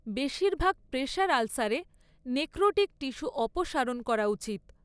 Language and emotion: Bengali, neutral